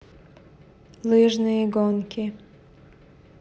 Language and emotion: Russian, neutral